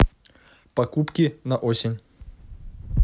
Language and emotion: Russian, neutral